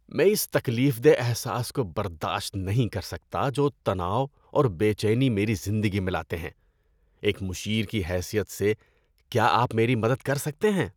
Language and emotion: Urdu, disgusted